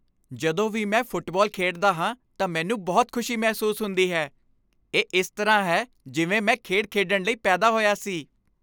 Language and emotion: Punjabi, happy